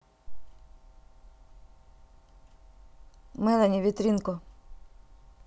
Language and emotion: Russian, neutral